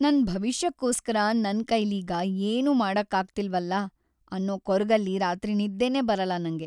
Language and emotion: Kannada, sad